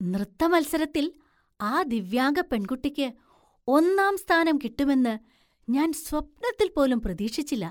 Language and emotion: Malayalam, surprised